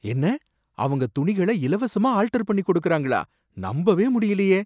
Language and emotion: Tamil, surprised